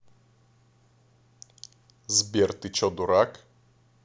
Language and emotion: Russian, neutral